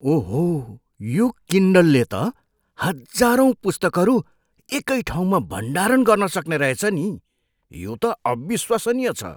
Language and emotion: Nepali, surprised